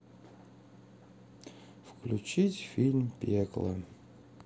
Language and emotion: Russian, sad